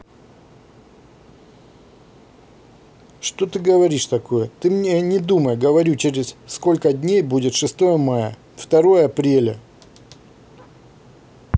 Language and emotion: Russian, angry